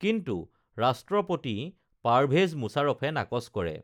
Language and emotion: Assamese, neutral